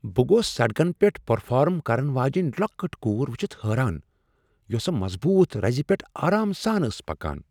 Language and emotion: Kashmiri, surprised